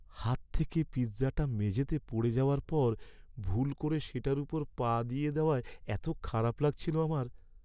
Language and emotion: Bengali, sad